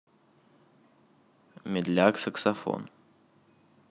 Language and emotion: Russian, neutral